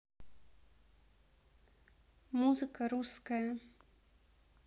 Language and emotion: Russian, neutral